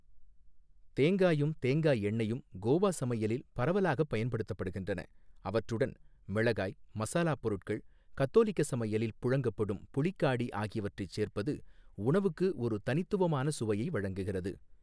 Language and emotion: Tamil, neutral